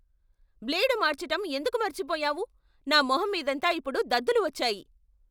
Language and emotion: Telugu, angry